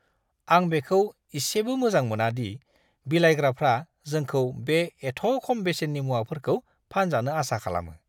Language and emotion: Bodo, disgusted